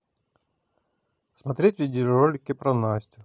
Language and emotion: Russian, neutral